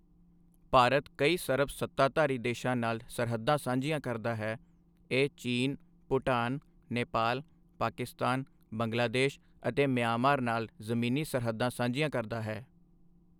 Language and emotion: Punjabi, neutral